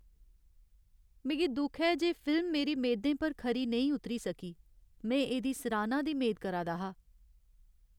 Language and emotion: Dogri, sad